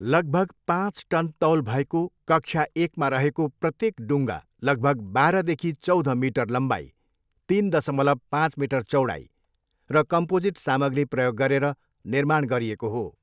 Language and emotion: Nepali, neutral